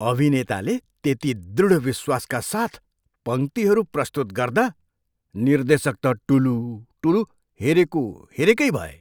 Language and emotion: Nepali, surprised